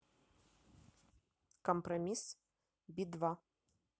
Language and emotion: Russian, neutral